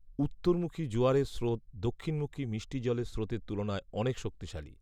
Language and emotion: Bengali, neutral